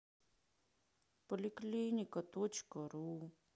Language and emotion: Russian, sad